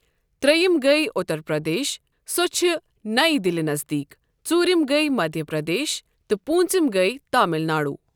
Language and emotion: Kashmiri, neutral